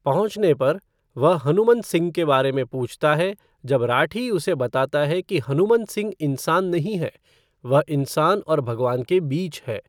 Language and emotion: Hindi, neutral